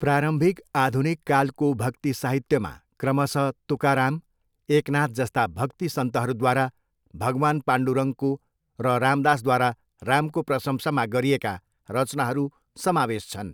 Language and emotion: Nepali, neutral